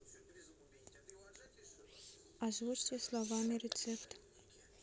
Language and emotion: Russian, neutral